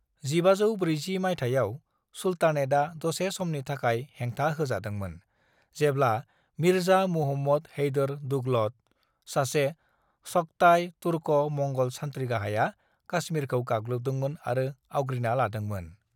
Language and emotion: Bodo, neutral